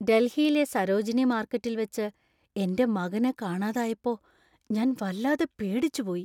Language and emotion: Malayalam, fearful